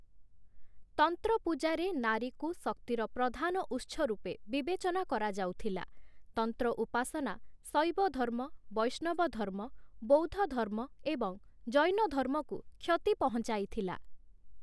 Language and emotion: Odia, neutral